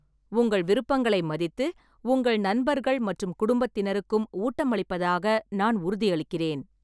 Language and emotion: Tamil, neutral